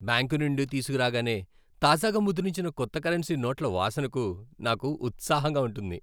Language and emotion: Telugu, happy